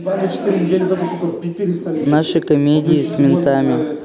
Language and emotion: Russian, neutral